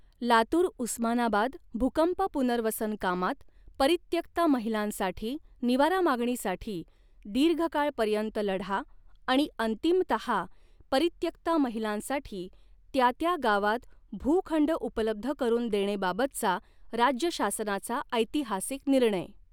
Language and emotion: Marathi, neutral